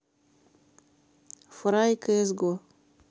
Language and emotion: Russian, neutral